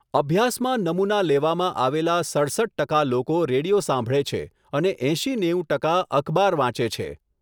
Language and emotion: Gujarati, neutral